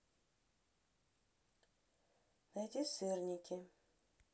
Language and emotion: Russian, neutral